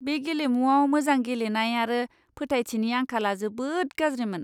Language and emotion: Bodo, disgusted